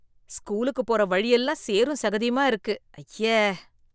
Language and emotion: Tamil, disgusted